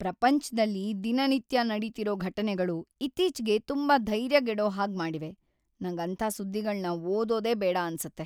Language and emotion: Kannada, sad